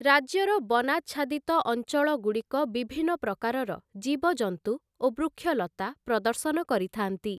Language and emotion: Odia, neutral